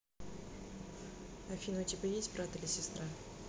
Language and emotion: Russian, neutral